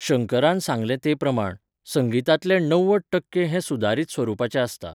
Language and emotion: Goan Konkani, neutral